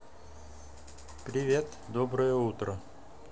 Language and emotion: Russian, neutral